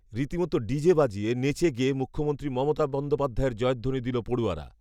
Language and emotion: Bengali, neutral